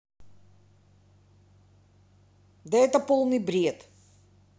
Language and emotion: Russian, angry